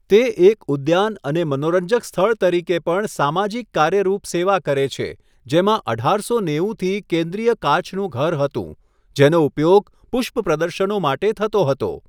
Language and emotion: Gujarati, neutral